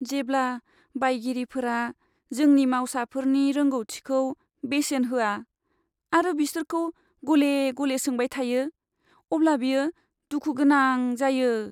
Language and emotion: Bodo, sad